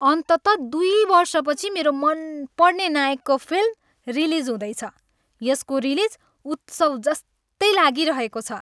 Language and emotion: Nepali, happy